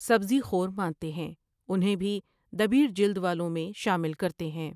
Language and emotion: Urdu, neutral